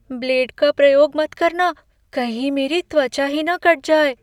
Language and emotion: Hindi, fearful